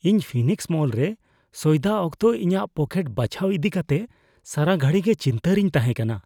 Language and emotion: Santali, fearful